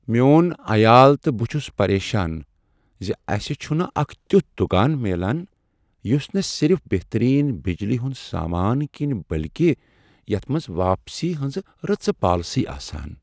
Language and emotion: Kashmiri, sad